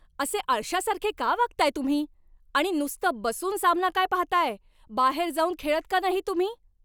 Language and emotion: Marathi, angry